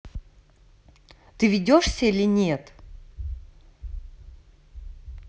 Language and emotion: Russian, angry